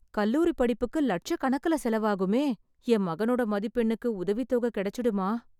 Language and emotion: Tamil, sad